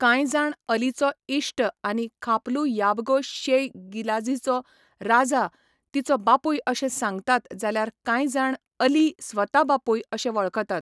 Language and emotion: Goan Konkani, neutral